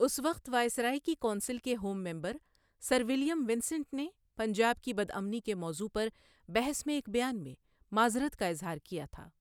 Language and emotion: Urdu, neutral